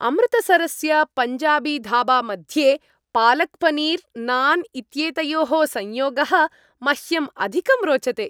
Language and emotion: Sanskrit, happy